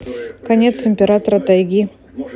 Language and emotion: Russian, neutral